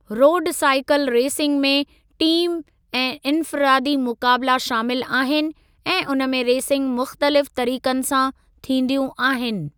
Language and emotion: Sindhi, neutral